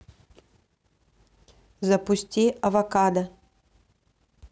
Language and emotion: Russian, neutral